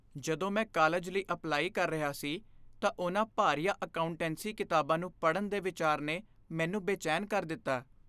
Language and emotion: Punjabi, fearful